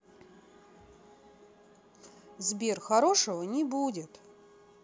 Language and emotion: Russian, neutral